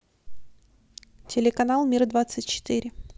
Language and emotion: Russian, neutral